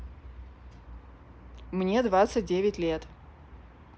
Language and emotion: Russian, neutral